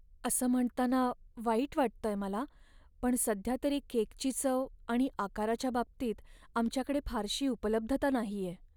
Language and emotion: Marathi, sad